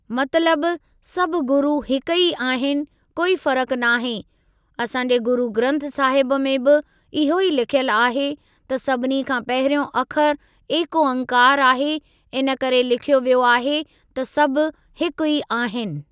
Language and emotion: Sindhi, neutral